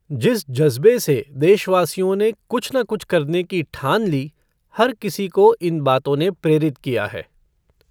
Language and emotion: Hindi, neutral